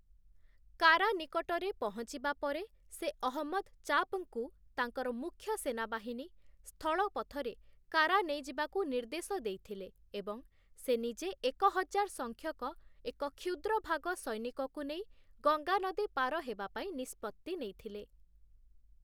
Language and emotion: Odia, neutral